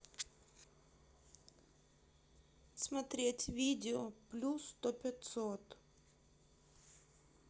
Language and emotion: Russian, neutral